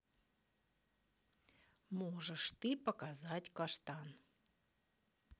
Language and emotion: Russian, neutral